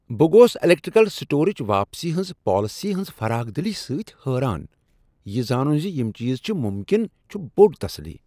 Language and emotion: Kashmiri, surprised